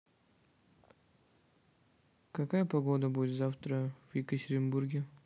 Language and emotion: Russian, neutral